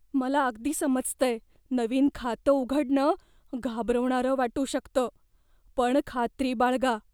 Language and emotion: Marathi, fearful